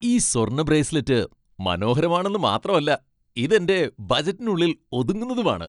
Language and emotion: Malayalam, happy